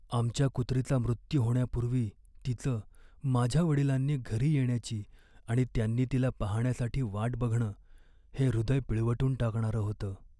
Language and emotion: Marathi, sad